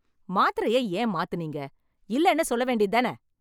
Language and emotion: Tamil, angry